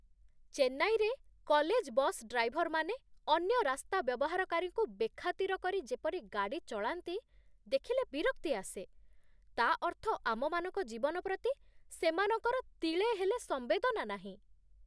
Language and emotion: Odia, disgusted